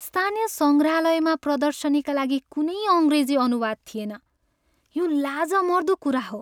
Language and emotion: Nepali, sad